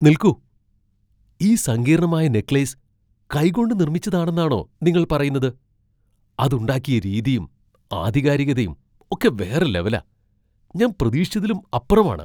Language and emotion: Malayalam, surprised